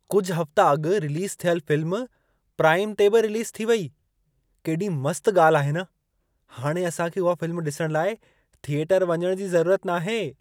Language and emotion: Sindhi, surprised